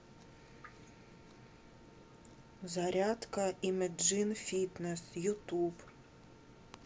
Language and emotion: Russian, neutral